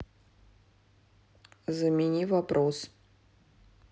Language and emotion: Russian, neutral